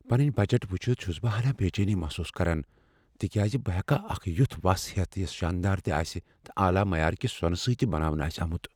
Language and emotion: Kashmiri, fearful